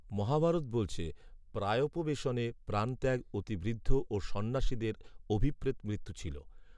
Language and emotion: Bengali, neutral